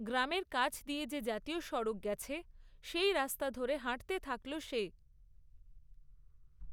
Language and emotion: Bengali, neutral